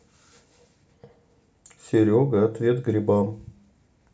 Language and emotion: Russian, neutral